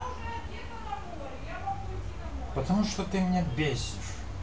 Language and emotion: Russian, angry